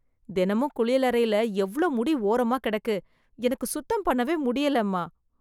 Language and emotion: Tamil, disgusted